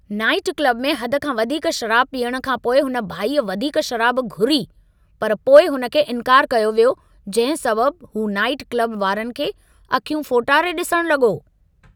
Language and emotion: Sindhi, angry